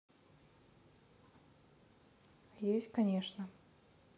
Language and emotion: Russian, neutral